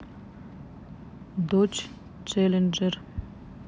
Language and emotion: Russian, neutral